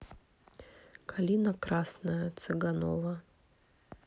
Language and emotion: Russian, neutral